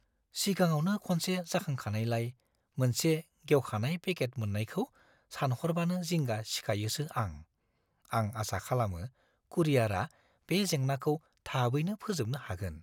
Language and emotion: Bodo, fearful